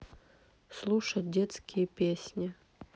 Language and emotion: Russian, neutral